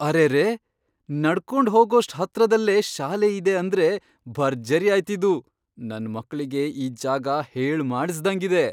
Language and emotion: Kannada, surprised